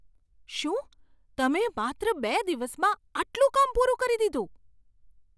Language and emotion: Gujarati, surprised